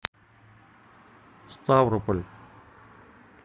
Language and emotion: Russian, neutral